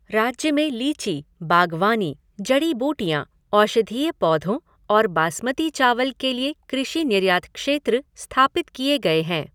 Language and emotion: Hindi, neutral